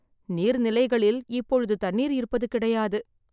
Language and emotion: Tamil, sad